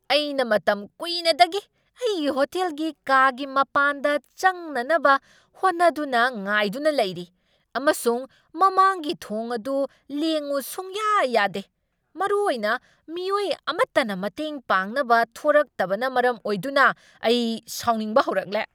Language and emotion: Manipuri, angry